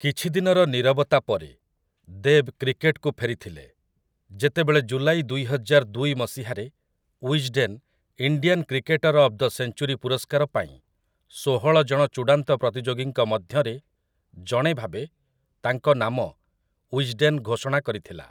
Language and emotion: Odia, neutral